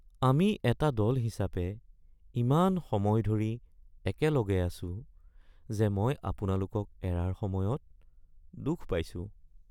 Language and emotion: Assamese, sad